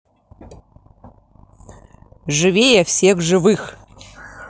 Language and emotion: Russian, positive